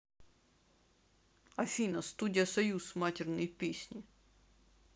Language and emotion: Russian, neutral